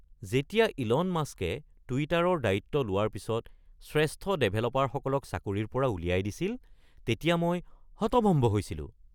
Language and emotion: Assamese, surprised